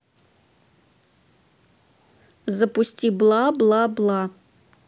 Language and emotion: Russian, neutral